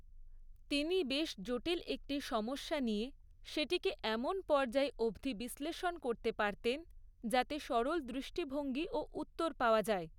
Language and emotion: Bengali, neutral